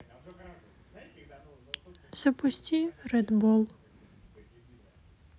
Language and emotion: Russian, sad